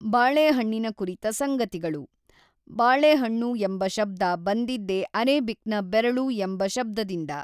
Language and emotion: Kannada, neutral